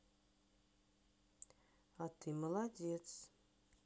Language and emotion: Russian, positive